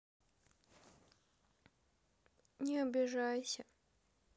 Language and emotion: Russian, sad